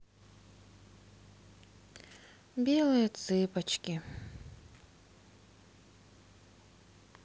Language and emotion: Russian, sad